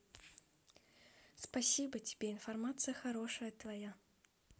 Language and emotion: Russian, positive